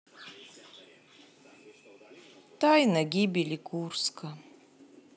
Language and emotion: Russian, sad